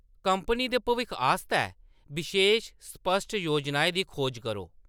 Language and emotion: Dogri, neutral